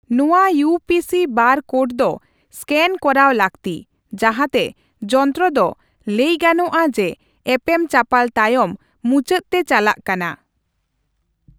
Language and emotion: Santali, neutral